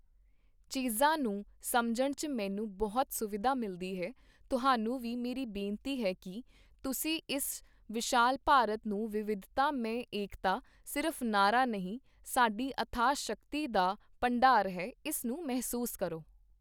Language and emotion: Punjabi, neutral